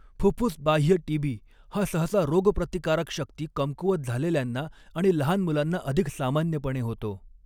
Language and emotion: Marathi, neutral